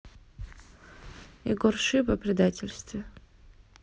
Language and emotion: Russian, neutral